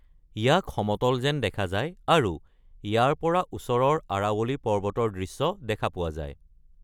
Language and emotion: Assamese, neutral